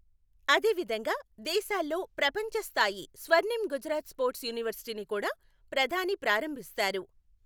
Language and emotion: Telugu, neutral